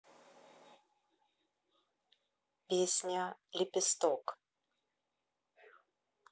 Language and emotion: Russian, neutral